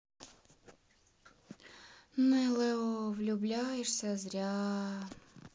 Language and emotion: Russian, sad